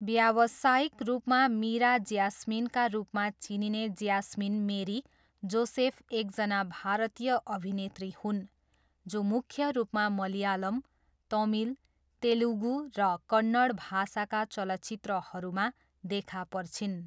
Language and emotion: Nepali, neutral